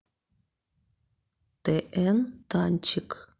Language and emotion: Russian, neutral